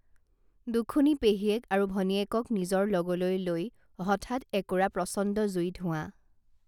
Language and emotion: Assamese, neutral